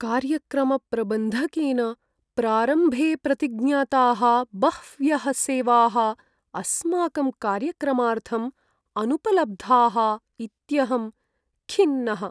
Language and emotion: Sanskrit, sad